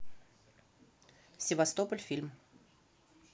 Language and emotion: Russian, neutral